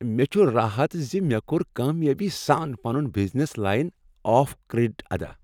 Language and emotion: Kashmiri, happy